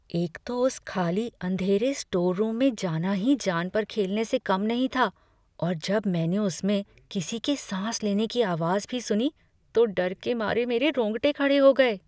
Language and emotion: Hindi, fearful